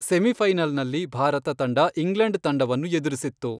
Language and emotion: Kannada, neutral